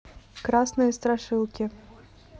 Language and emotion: Russian, neutral